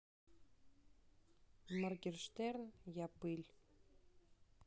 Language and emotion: Russian, neutral